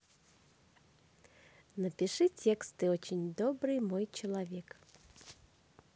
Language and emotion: Russian, positive